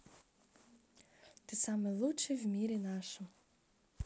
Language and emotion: Russian, positive